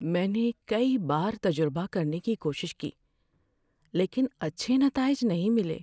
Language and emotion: Urdu, sad